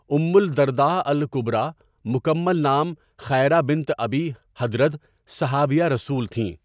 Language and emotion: Urdu, neutral